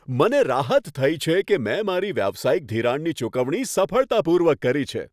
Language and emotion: Gujarati, happy